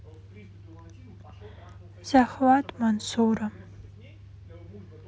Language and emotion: Russian, sad